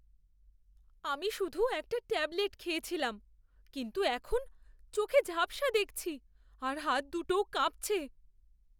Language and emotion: Bengali, fearful